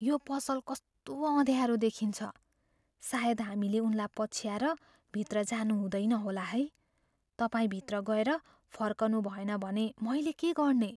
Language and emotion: Nepali, fearful